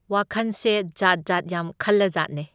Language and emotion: Manipuri, neutral